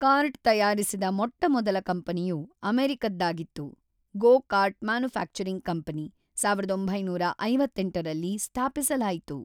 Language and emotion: Kannada, neutral